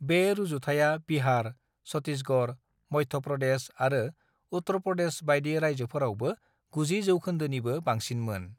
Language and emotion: Bodo, neutral